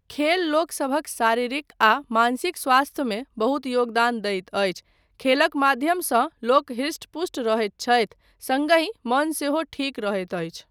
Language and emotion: Maithili, neutral